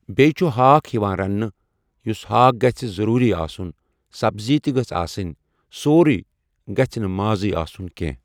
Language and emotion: Kashmiri, neutral